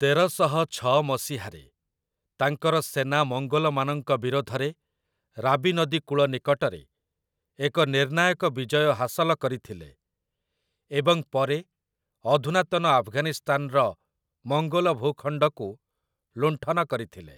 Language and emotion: Odia, neutral